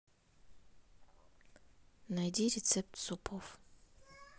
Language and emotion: Russian, neutral